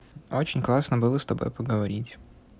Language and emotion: Russian, neutral